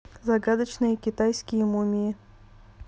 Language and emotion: Russian, neutral